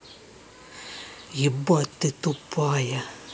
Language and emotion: Russian, angry